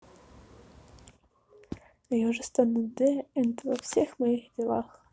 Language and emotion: Russian, neutral